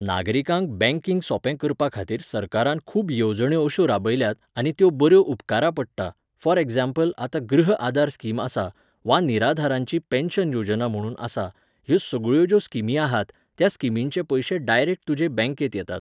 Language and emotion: Goan Konkani, neutral